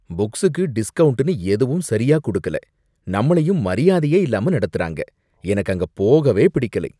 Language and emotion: Tamil, disgusted